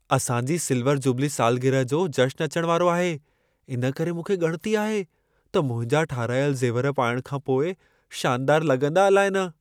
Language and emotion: Sindhi, fearful